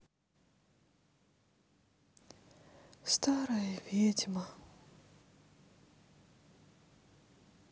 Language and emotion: Russian, sad